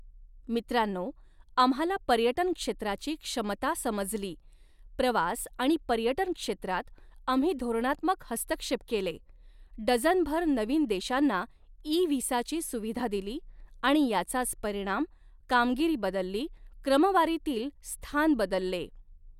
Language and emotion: Marathi, neutral